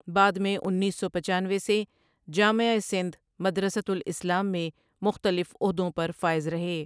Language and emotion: Urdu, neutral